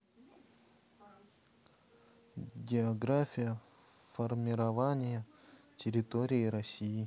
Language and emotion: Russian, neutral